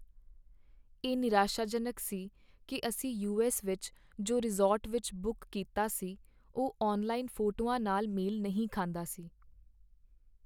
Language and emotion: Punjabi, sad